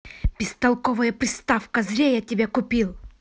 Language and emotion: Russian, angry